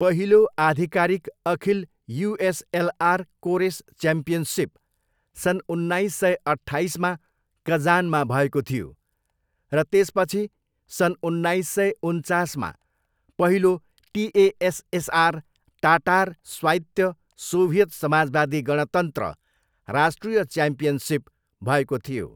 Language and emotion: Nepali, neutral